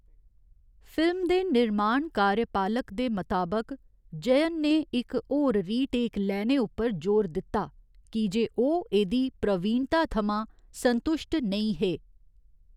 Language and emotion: Dogri, neutral